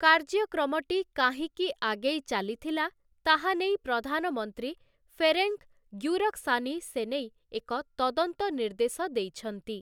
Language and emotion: Odia, neutral